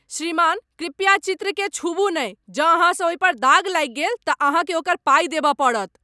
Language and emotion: Maithili, angry